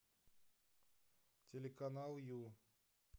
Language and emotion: Russian, neutral